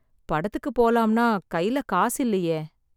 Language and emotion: Tamil, sad